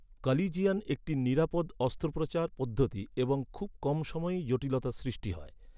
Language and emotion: Bengali, neutral